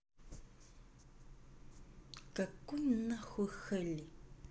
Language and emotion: Russian, angry